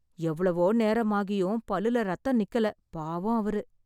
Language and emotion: Tamil, sad